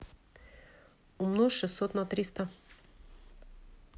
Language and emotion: Russian, neutral